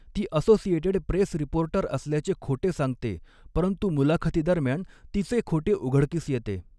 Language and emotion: Marathi, neutral